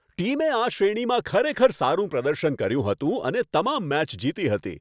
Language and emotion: Gujarati, happy